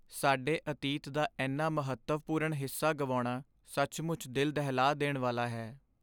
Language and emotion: Punjabi, sad